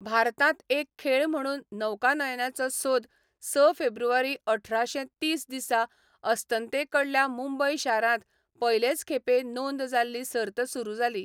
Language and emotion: Goan Konkani, neutral